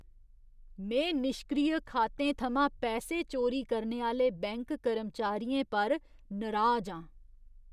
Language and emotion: Dogri, disgusted